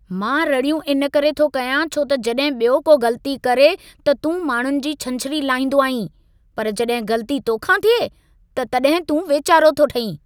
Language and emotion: Sindhi, angry